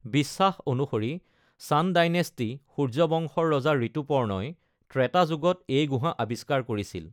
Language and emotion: Assamese, neutral